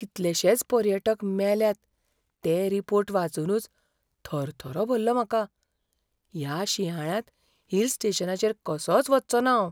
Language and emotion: Goan Konkani, fearful